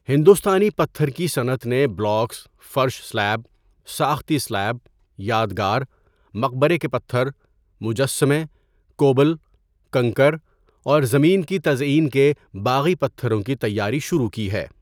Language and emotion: Urdu, neutral